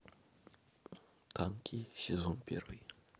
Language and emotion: Russian, neutral